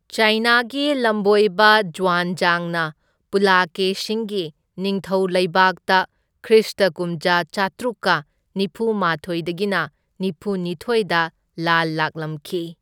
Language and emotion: Manipuri, neutral